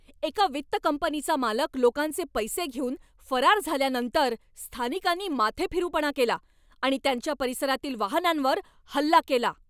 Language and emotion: Marathi, angry